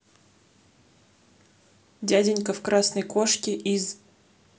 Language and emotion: Russian, neutral